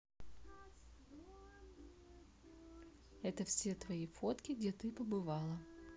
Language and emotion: Russian, neutral